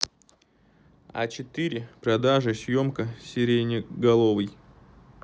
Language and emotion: Russian, neutral